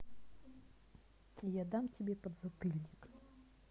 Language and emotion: Russian, angry